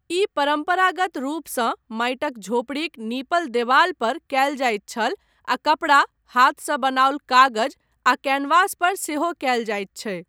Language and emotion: Maithili, neutral